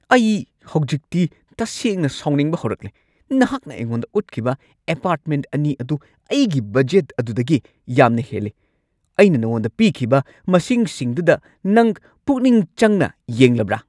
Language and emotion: Manipuri, angry